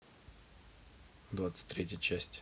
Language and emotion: Russian, neutral